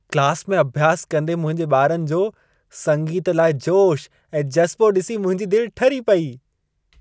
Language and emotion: Sindhi, happy